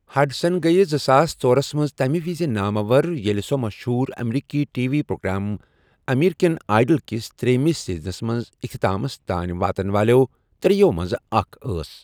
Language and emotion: Kashmiri, neutral